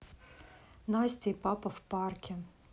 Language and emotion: Russian, neutral